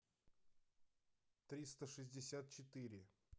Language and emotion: Russian, neutral